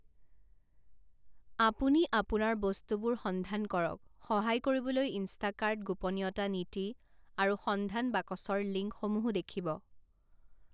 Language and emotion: Assamese, neutral